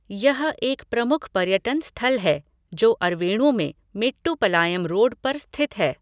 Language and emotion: Hindi, neutral